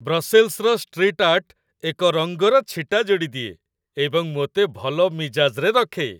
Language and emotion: Odia, happy